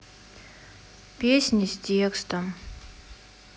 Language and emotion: Russian, sad